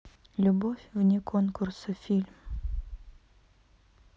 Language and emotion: Russian, neutral